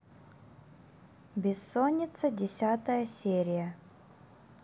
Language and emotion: Russian, neutral